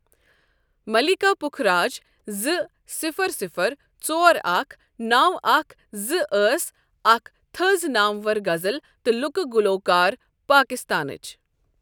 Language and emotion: Kashmiri, neutral